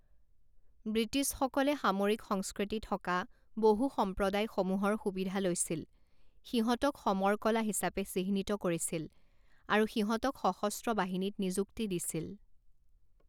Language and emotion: Assamese, neutral